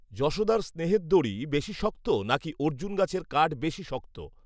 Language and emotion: Bengali, neutral